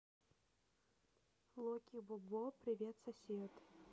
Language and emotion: Russian, neutral